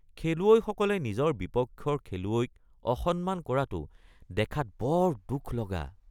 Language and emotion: Assamese, disgusted